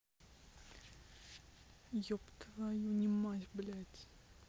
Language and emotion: Russian, angry